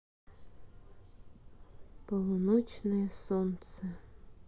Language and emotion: Russian, sad